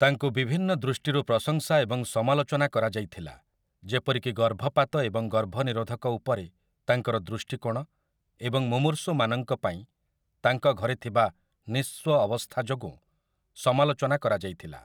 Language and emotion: Odia, neutral